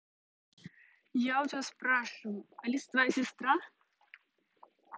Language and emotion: Russian, neutral